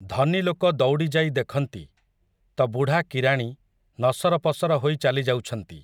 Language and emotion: Odia, neutral